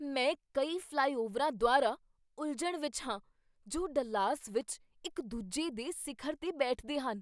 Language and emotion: Punjabi, surprised